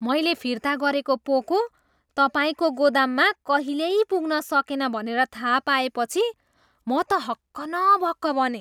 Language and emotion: Nepali, surprised